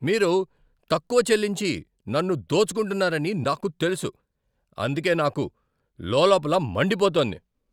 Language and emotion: Telugu, angry